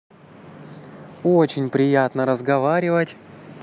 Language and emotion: Russian, positive